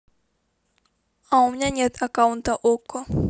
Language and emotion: Russian, neutral